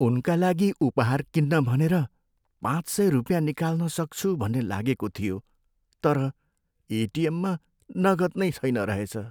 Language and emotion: Nepali, sad